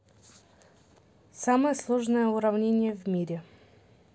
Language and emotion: Russian, neutral